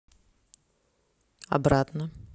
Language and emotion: Russian, neutral